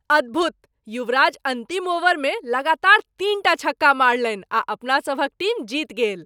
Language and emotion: Maithili, surprised